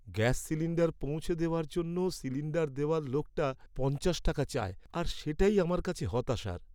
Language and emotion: Bengali, sad